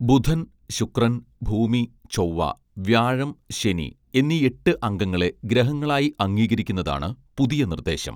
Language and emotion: Malayalam, neutral